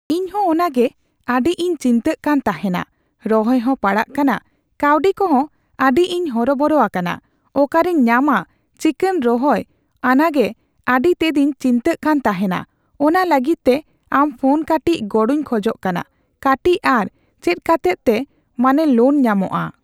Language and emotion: Santali, neutral